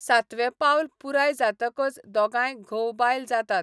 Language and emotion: Goan Konkani, neutral